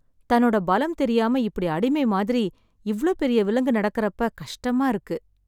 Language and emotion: Tamil, sad